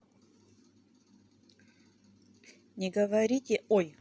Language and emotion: Russian, neutral